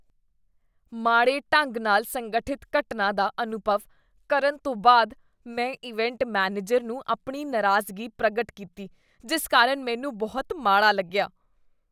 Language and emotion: Punjabi, disgusted